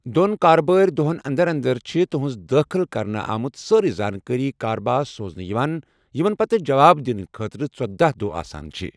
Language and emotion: Kashmiri, neutral